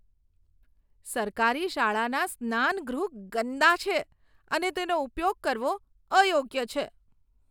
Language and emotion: Gujarati, disgusted